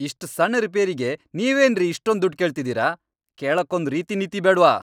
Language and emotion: Kannada, angry